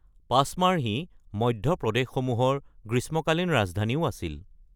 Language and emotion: Assamese, neutral